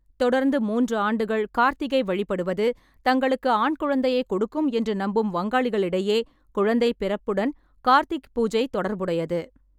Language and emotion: Tamil, neutral